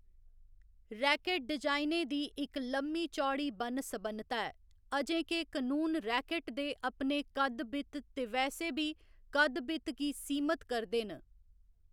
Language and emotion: Dogri, neutral